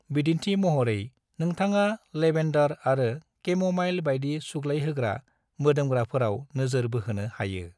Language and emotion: Bodo, neutral